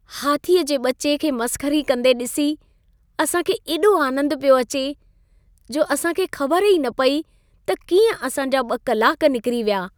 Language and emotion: Sindhi, happy